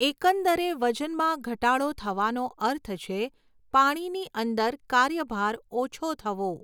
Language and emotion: Gujarati, neutral